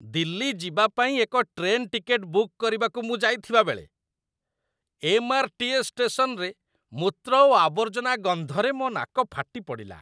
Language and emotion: Odia, disgusted